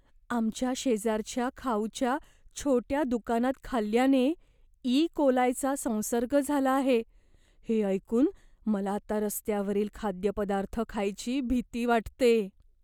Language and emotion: Marathi, fearful